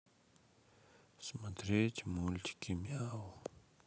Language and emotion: Russian, sad